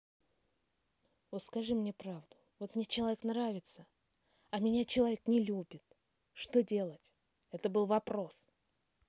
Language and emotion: Russian, angry